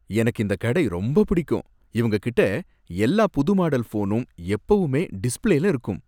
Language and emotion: Tamil, happy